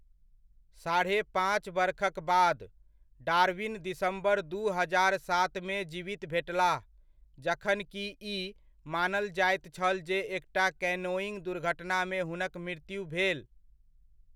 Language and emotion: Maithili, neutral